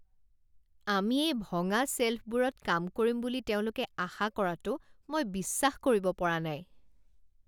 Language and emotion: Assamese, disgusted